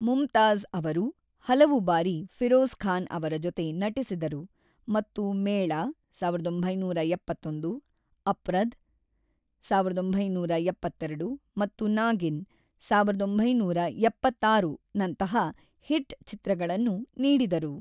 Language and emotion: Kannada, neutral